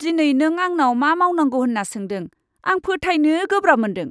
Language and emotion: Bodo, disgusted